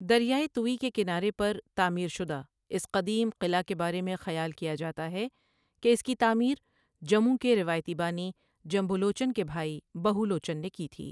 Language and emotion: Urdu, neutral